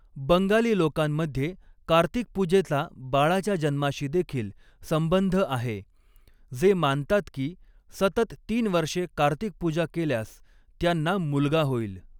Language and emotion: Marathi, neutral